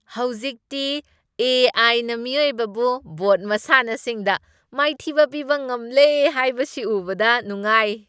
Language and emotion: Manipuri, happy